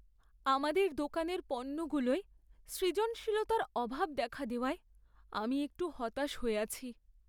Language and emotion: Bengali, sad